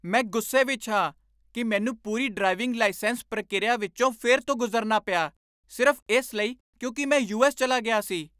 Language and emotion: Punjabi, angry